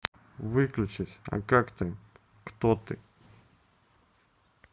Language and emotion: Russian, neutral